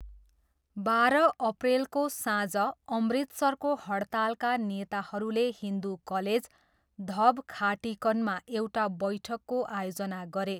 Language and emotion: Nepali, neutral